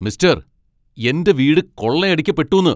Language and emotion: Malayalam, angry